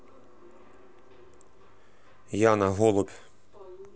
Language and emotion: Russian, neutral